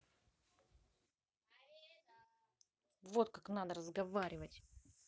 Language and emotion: Russian, angry